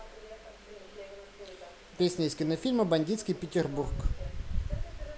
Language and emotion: Russian, neutral